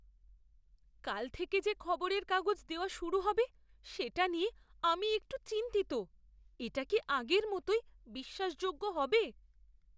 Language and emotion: Bengali, fearful